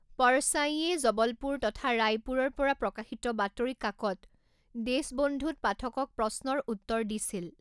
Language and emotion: Assamese, neutral